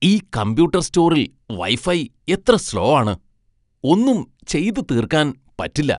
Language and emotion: Malayalam, disgusted